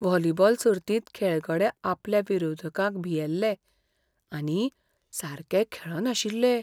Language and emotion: Goan Konkani, fearful